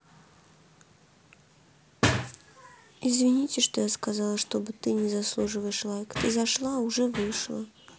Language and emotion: Russian, sad